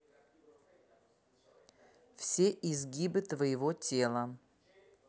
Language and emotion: Russian, neutral